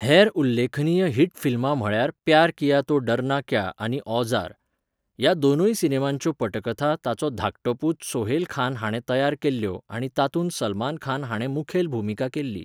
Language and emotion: Goan Konkani, neutral